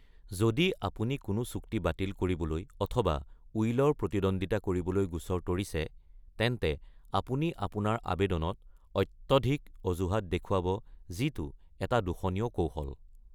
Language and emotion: Assamese, neutral